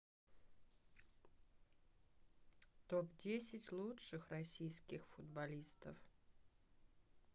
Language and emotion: Russian, neutral